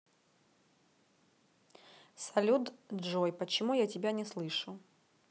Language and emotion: Russian, neutral